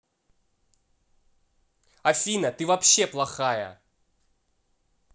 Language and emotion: Russian, angry